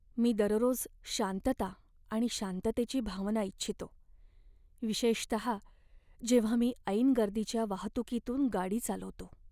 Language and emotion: Marathi, sad